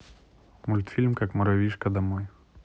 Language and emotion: Russian, neutral